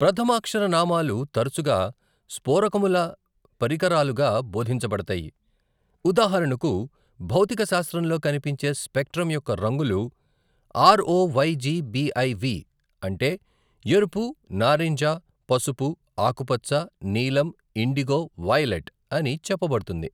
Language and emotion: Telugu, neutral